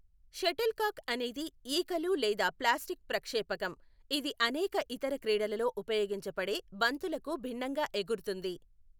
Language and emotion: Telugu, neutral